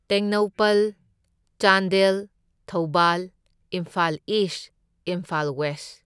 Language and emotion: Manipuri, neutral